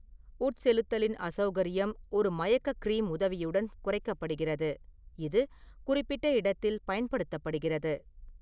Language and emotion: Tamil, neutral